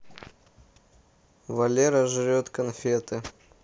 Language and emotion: Russian, neutral